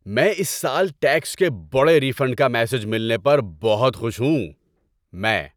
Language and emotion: Urdu, happy